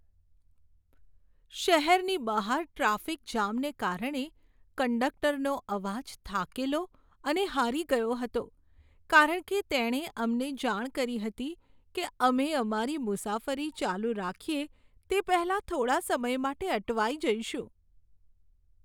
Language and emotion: Gujarati, sad